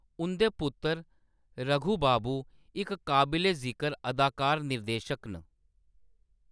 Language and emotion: Dogri, neutral